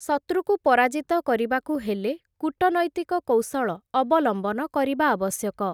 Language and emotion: Odia, neutral